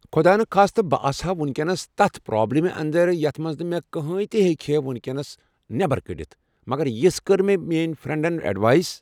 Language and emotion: Kashmiri, neutral